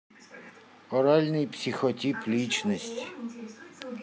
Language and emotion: Russian, neutral